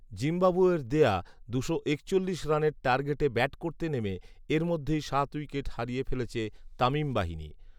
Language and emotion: Bengali, neutral